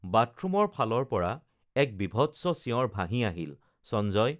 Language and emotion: Assamese, neutral